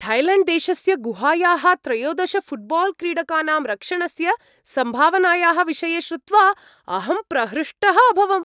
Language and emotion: Sanskrit, happy